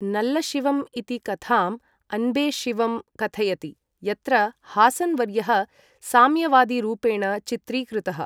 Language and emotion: Sanskrit, neutral